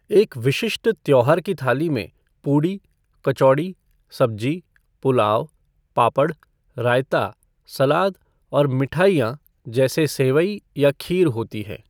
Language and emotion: Hindi, neutral